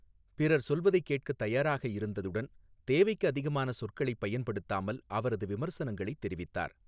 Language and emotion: Tamil, neutral